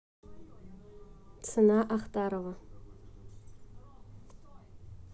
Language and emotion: Russian, neutral